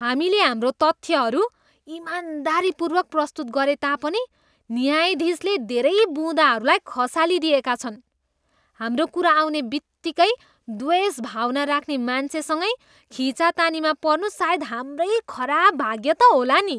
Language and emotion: Nepali, disgusted